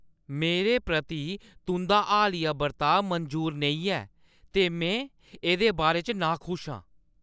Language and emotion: Dogri, angry